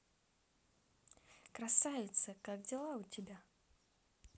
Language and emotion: Russian, positive